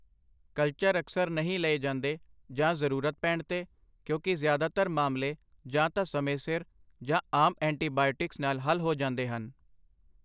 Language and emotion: Punjabi, neutral